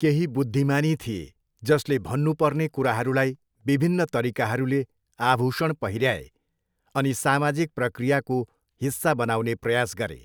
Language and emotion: Nepali, neutral